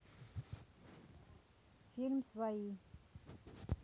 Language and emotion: Russian, neutral